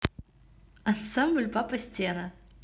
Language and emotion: Russian, neutral